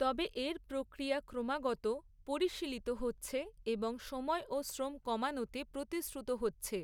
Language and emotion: Bengali, neutral